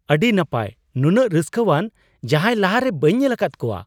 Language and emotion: Santali, surprised